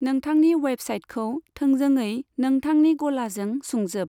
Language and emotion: Bodo, neutral